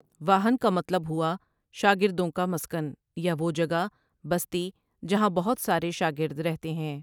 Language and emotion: Urdu, neutral